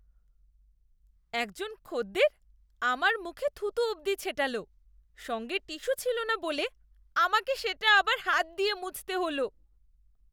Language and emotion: Bengali, disgusted